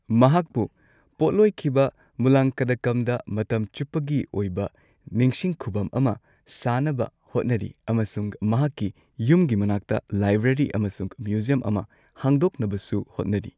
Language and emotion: Manipuri, neutral